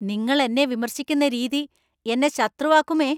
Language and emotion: Malayalam, angry